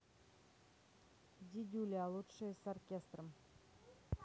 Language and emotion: Russian, neutral